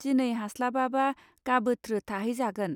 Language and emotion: Bodo, neutral